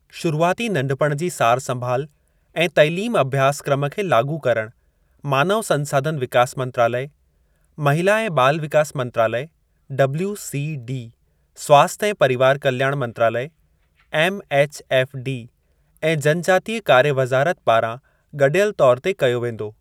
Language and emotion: Sindhi, neutral